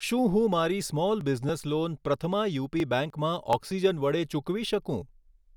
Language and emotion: Gujarati, neutral